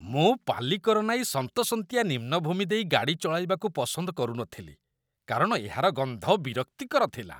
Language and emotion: Odia, disgusted